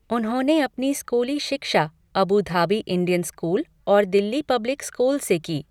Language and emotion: Hindi, neutral